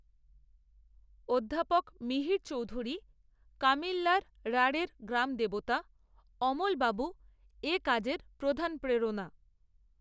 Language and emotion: Bengali, neutral